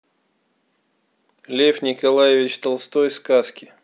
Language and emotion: Russian, neutral